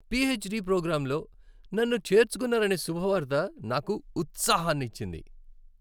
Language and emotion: Telugu, happy